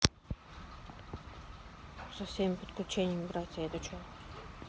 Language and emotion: Russian, sad